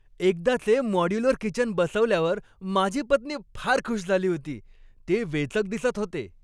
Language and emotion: Marathi, happy